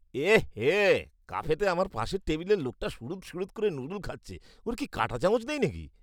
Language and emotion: Bengali, disgusted